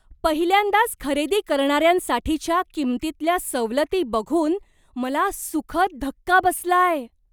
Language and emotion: Marathi, surprised